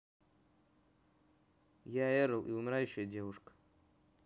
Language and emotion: Russian, neutral